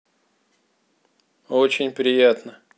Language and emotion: Russian, neutral